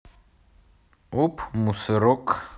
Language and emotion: Russian, neutral